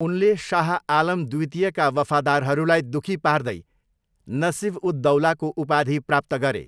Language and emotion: Nepali, neutral